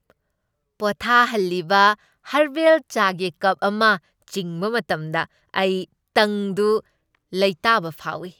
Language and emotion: Manipuri, happy